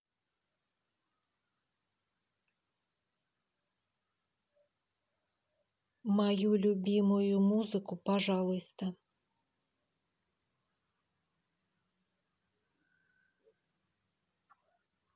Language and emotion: Russian, neutral